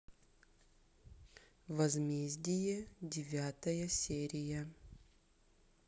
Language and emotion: Russian, neutral